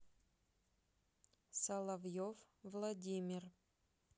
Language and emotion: Russian, neutral